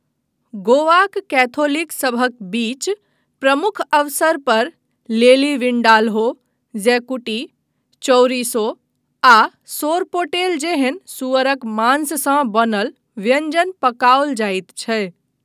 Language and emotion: Maithili, neutral